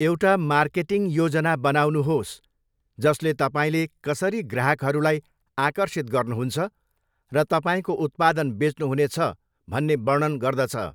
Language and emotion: Nepali, neutral